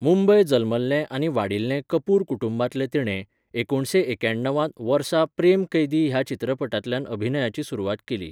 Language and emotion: Goan Konkani, neutral